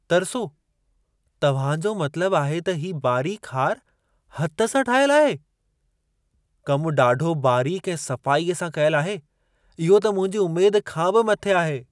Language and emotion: Sindhi, surprised